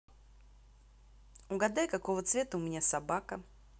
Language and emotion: Russian, neutral